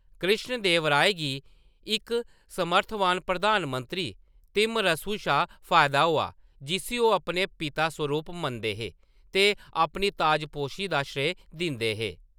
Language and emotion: Dogri, neutral